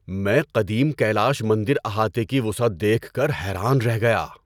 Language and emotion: Urdu, surprised